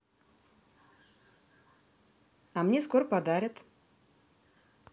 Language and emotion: Russian, positive